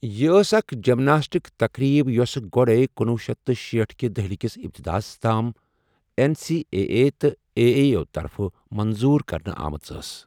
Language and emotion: Kashmiri, neutral